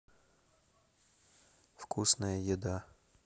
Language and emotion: Russian, neutral